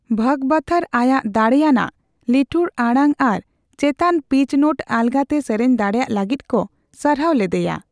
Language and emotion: Santali, neutral